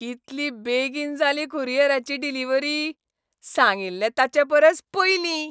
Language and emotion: Goan Konkani, happy